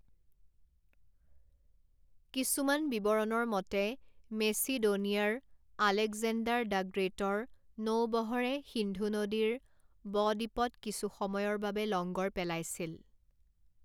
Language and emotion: Assamese, neutral